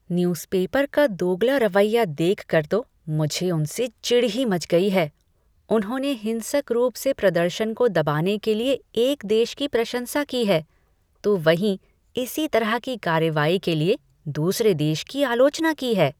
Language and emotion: Hindi, disgusted